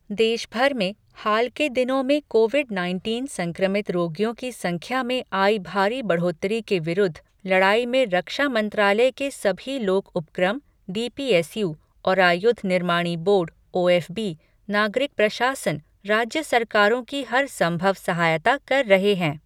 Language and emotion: Hindi, neutral